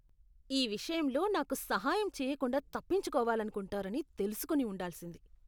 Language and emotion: Telugu, disgusted